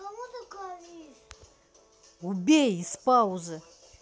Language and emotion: Russian, angry